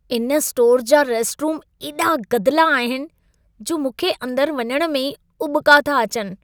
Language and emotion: Sindhi, disgusted